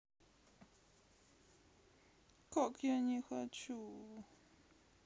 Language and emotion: Russian, sad